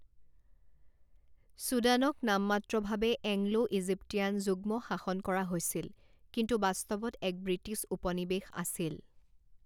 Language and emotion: Assamese, neutral